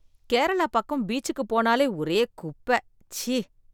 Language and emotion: Tamil, disgusted